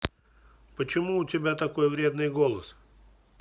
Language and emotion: Russian, neutral